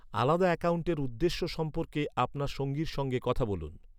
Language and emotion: Bengali, neutral